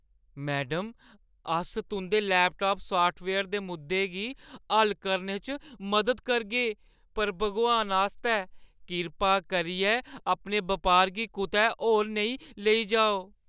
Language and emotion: Dogri, fearful